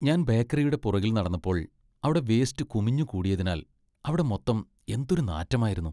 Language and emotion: Malayalam, disgusted